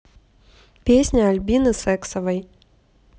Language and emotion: Russian, neutral